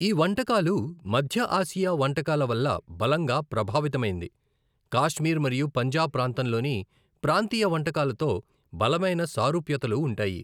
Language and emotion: Telugu, neutral